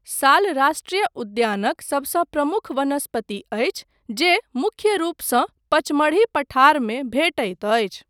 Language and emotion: Maithili, neutral